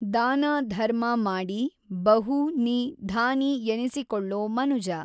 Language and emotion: Kannada, neutral